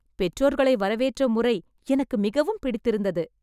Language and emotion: Tamil, happy